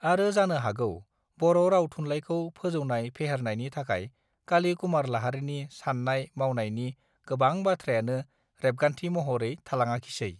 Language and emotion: Bodo, neutral